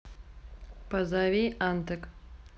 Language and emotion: Russian, neutral